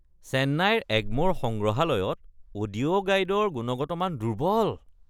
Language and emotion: Assamese, disgusted